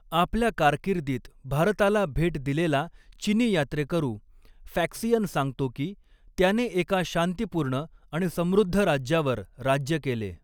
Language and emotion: Marathi, neutral